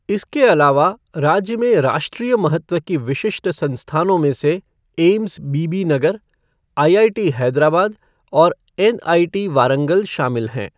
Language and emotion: Hindi, neutral